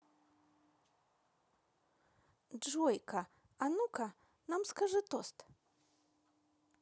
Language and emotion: Russian, positive